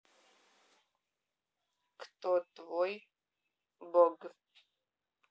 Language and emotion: Russian, neutral